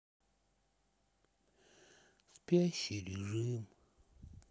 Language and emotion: Russian, sad